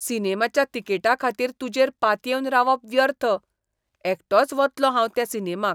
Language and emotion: Goan Konkani, disgusted